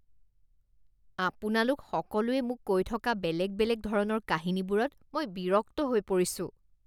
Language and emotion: Assamese, disgusted